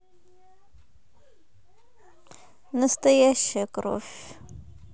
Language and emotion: Russian, sad